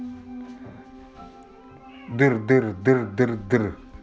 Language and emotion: Russian, neutral